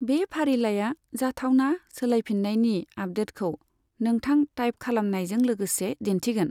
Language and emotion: Bodo, neutral